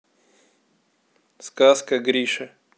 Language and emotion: Russian, neutral